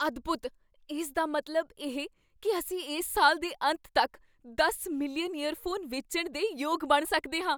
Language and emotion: Punjabi, surprised